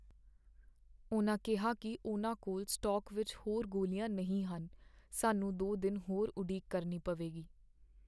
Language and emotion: Punjabi, sad